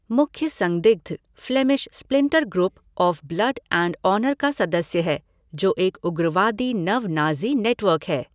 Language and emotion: Hindi, neutral